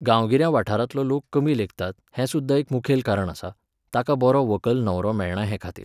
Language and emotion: Goan Konkani, neutral